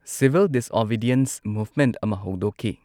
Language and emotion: Manipuri, neutral